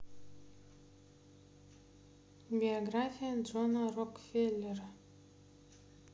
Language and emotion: Russian, neutral